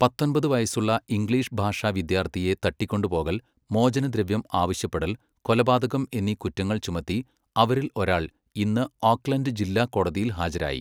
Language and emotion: Malayalam, neutral